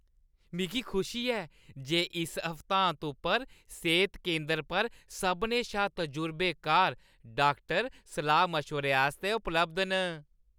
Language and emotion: Dogri, happy